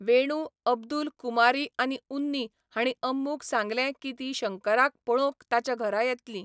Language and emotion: Goan Konkani, neutral